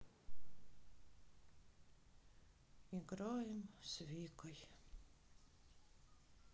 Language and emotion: Russian, sad